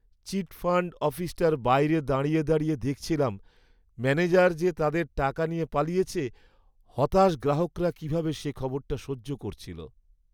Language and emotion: Bengali, sad